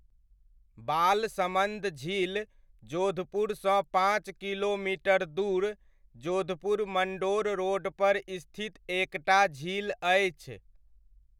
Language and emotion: Maithili, neutral